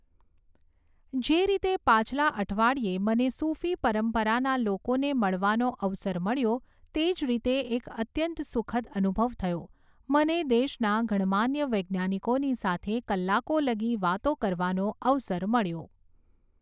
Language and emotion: Gujarati, neutral